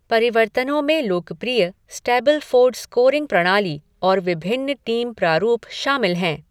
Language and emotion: Hindi, neutral